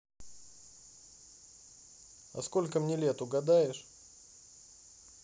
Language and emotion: Russian, neutral